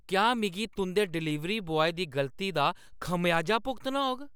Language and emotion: Dogri, angry